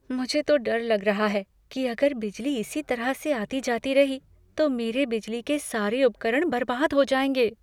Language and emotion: Hindi, fearful